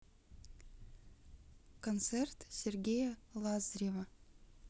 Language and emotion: Russian, neutral